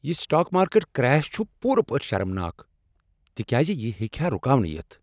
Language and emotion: Kashmiri, angry